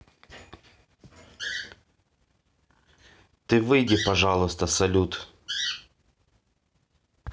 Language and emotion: Russian, neutral